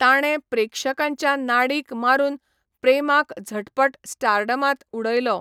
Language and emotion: Goan Konkani, neutral